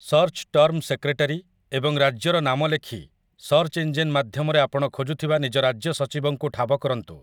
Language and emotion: Odia, neutral